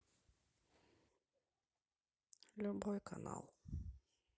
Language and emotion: Russian, neutral